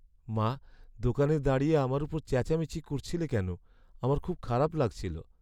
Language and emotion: Bengali, sad